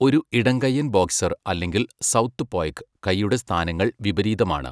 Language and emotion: Malayalam, neutral